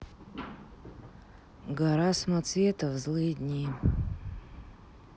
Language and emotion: Russian, neutral